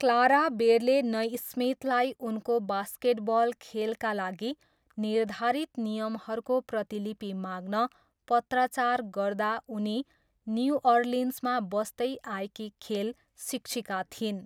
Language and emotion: Nepali, neutral